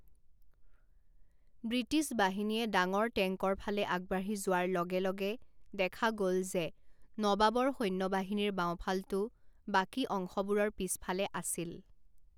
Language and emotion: Assamese, neutral